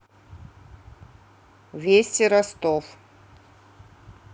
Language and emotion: Russian, neutral